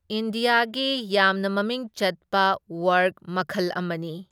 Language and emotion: Manipuri, neutral